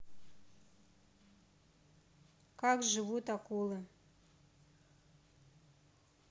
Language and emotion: Russian, neutral